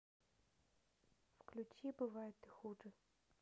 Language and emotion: Russian, neutral